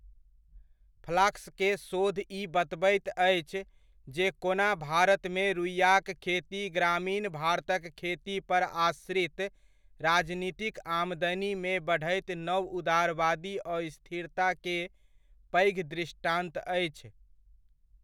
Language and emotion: Maithili, neutral